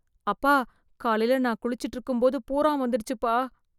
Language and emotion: Tamil, fearful